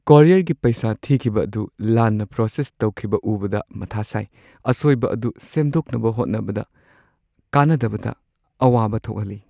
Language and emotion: Manipuri, sad